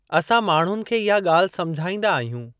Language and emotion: Sindhi, neutral